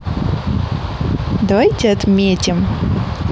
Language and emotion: Russian, positive